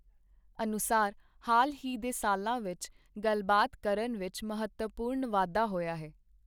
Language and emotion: Punjabi, neutral